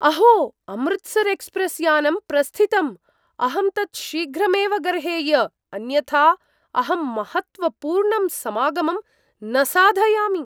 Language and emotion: Sanskrit, surprised